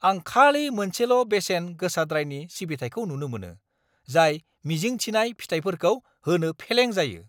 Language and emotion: Bodo, angry